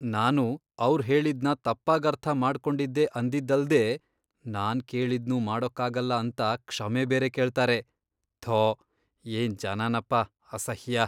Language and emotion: Kannada, disgusted